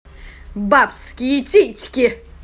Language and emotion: Russian, angry